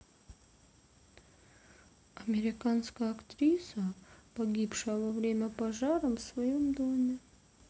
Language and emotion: Russian, neutral